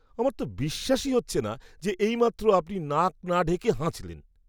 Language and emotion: Bengali, disgusted